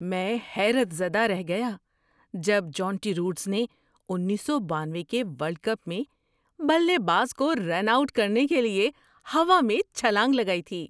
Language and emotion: Urdu, surprised